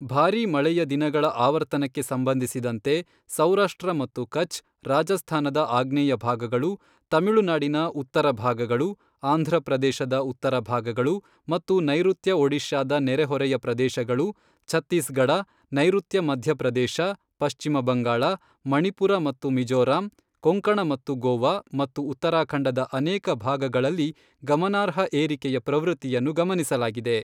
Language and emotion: Kannada, neutral